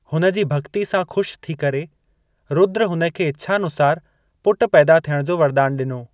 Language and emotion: Sindhi, neutral